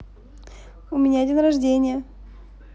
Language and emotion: Russian, positive